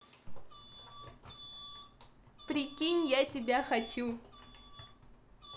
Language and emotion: Russian, positive